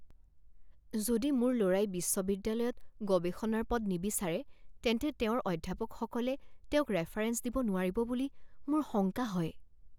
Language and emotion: Assamese, fearful